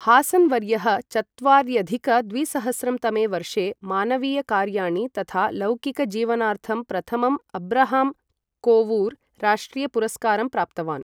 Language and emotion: Sanskrit, neutral